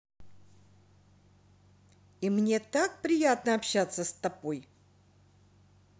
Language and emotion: Russian, positive